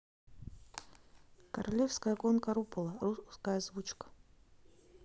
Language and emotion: Russian, neutral